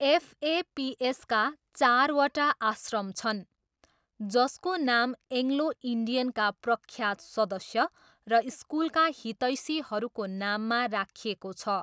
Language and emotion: Nepali, neutral